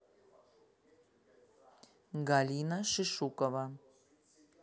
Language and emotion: Russian, neutral